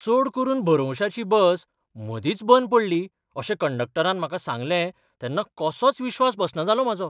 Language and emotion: Goan Konkani, surprised